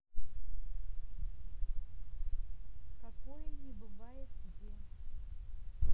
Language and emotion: Russian, neutral